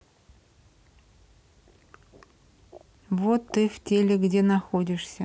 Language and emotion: Russian, neutral